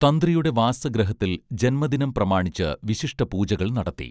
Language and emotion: Malayalam, neutral